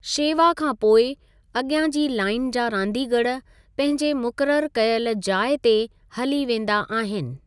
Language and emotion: Sindhi, neutral